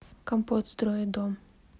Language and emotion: Russian, neutral